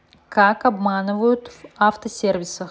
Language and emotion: Russian, neutral